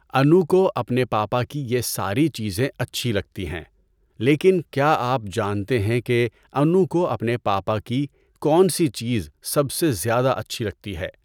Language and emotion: Urdu, neutral